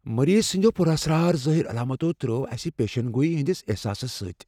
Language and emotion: Kashmiri, fearful